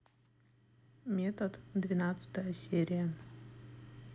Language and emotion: Russian, neutral